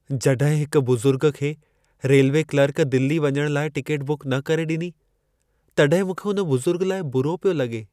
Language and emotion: Sindhi, sad